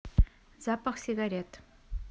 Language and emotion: Russian, neutral